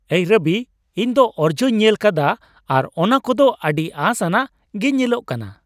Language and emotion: Santali, happy